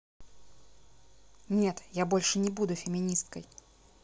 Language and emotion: Russian, angry